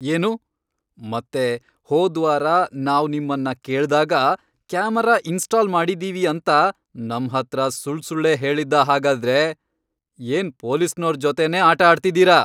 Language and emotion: Kannada, angry